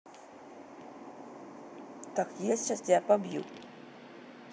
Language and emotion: Russian, neutral